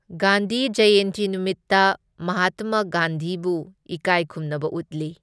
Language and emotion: Manipuri, neutral